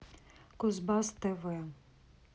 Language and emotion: Russian, neutral